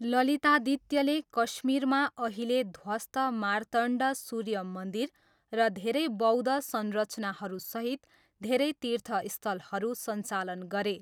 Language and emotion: Nepali, neutral